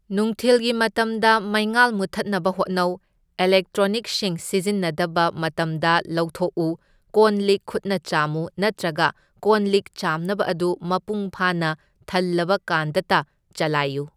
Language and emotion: Manipuri, neutral